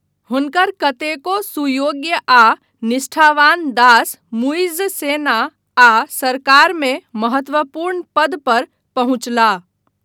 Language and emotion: Maithili, neutral